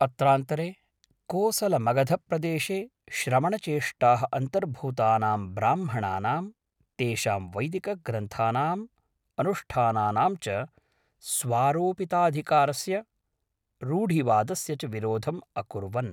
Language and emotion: Sanskrit, neutral